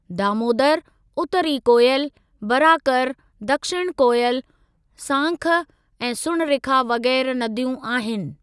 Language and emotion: Sindhi, neutral